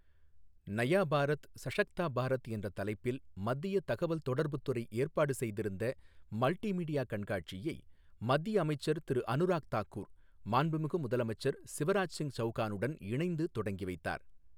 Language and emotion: Tamil, neutral